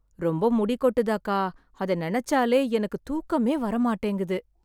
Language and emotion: Tamil, sad